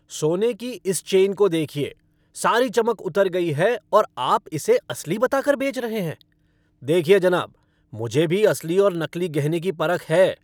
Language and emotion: Hindi, angry